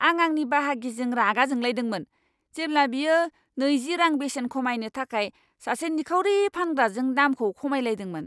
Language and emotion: Bodo, angry